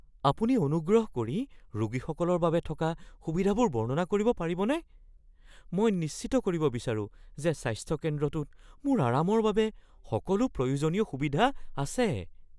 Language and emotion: Assamese, fearful